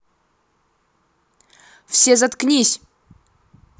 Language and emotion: Russian, angry